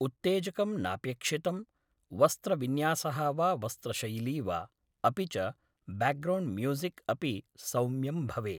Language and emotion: Sanskrit, neutral